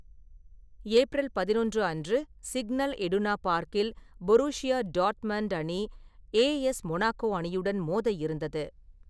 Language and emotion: Tamil, neutral